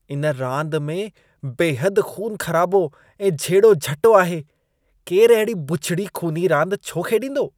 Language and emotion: Sindhi, disgusted